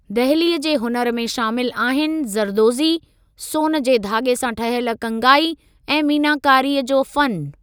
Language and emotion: Sindhi, neutral